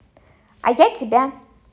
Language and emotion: Russian, positive